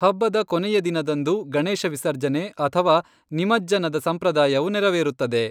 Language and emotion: Kannada, neutral